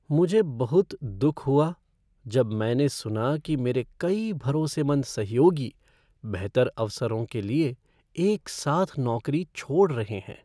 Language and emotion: Hindi, sad